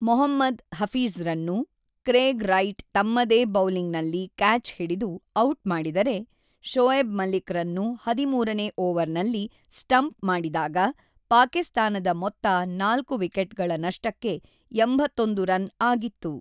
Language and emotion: Kannada, neutral